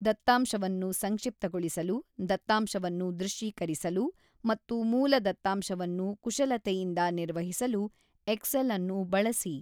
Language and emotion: Kannada, neutral